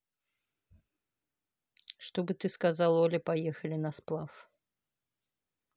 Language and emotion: Russian, neutral